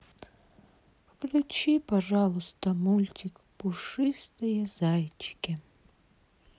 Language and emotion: Russian, sad